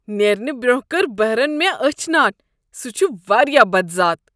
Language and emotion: Kashmiri, disgusted